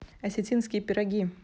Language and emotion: Russian, neutral